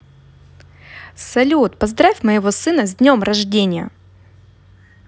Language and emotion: Russian, positive